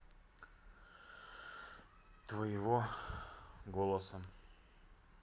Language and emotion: Russian, sad